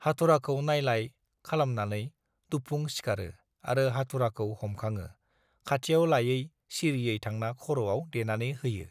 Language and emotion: Bodo, neutral